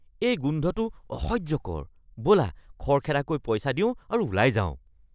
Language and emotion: Assamese, disgusted